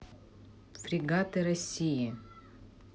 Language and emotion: Russian, neutral